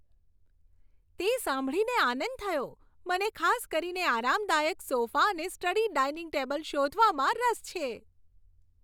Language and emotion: Gujarati, happy